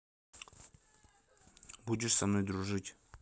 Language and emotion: Russian, neutral